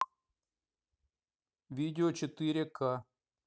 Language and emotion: Russian, neutral